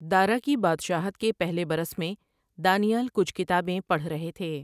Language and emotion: Urdu, neutral